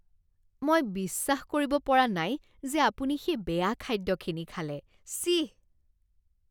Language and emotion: Assamese, disgusted